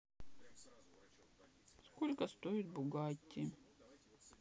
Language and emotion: Russian, sad